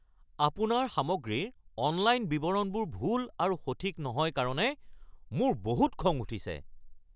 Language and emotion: Assamese, angry